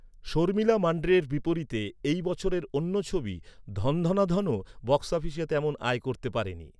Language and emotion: Bengali, neutral